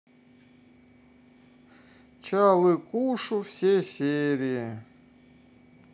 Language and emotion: Russian, sad